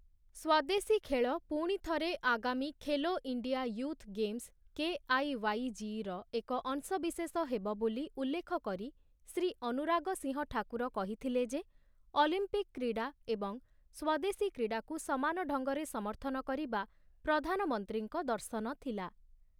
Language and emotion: Odia, neutral